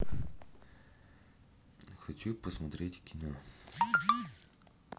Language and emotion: Russian, neutral